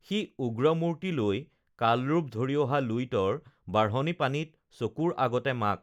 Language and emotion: Assamese, neutral